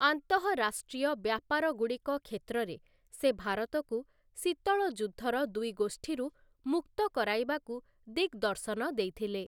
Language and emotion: Odia, neutral